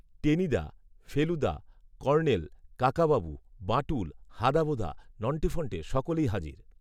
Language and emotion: Bengali, neutral